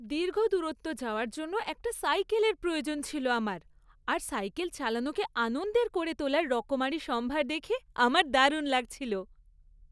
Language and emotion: Bengali, happy